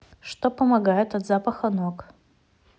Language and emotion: Russian, neutral